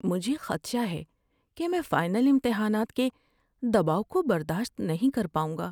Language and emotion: Urdu, fearful